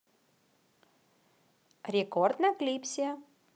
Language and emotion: Russian, positive